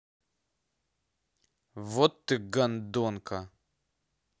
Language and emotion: Russian, angry